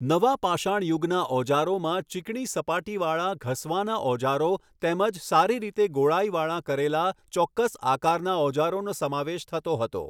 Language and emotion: Gujarati, neutral